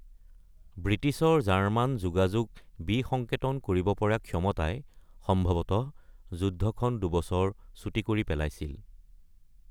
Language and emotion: Assamese, neutral